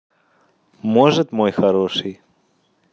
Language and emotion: Russian, positive